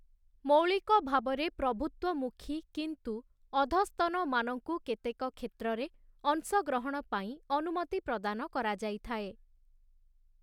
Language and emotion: Odia, neutral